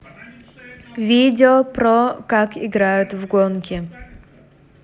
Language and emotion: Russian, neutral